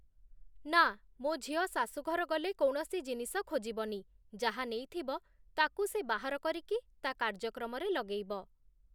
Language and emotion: Odia, neutral